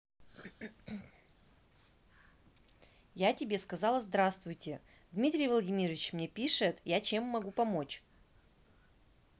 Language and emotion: Russian, angry